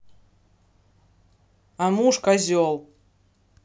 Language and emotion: Russian, angry